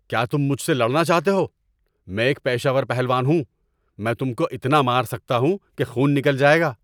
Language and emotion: Urdu, angry